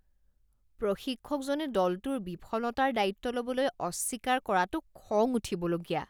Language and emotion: Assamese, disgusted